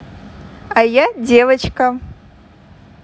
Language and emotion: Russian, positive